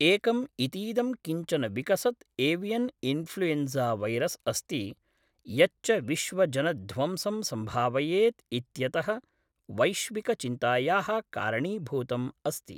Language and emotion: Sanskrit, neutral